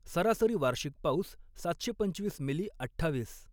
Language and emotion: Marathi, neutral